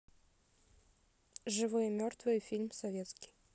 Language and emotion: Russian, neutral